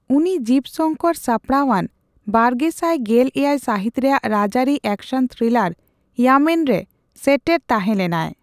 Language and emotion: Santali, neutral